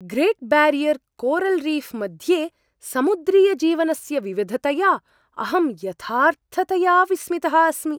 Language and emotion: Sanskrit, surprised